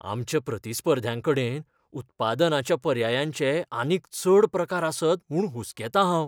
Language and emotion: Goan Konkani, fearful